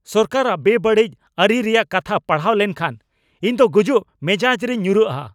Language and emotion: Santali, angry